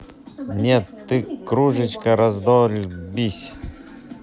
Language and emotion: Russian, neutral